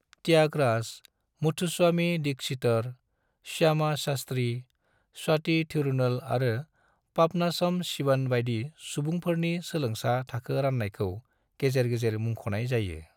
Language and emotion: Bodo, neutral